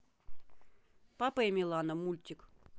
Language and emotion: Russian, neutral